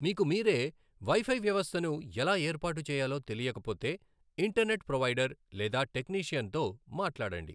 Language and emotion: Telugu, neutral